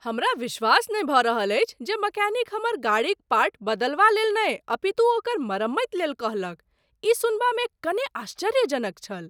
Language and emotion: Maithili, surprised